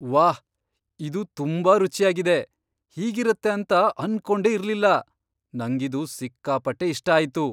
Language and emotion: Kannada, surprised